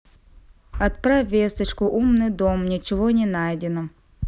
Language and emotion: Russian, neutral